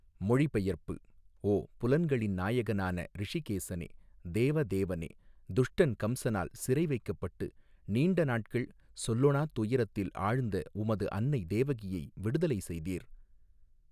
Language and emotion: Tamil, neutral